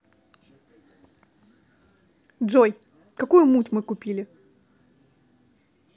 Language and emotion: Russian, neutral